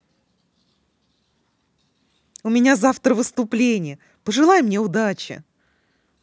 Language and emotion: Russian, positive